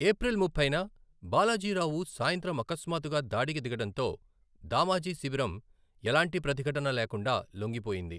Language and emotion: Telugu, neutral